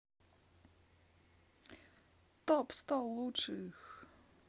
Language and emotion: Russian, positive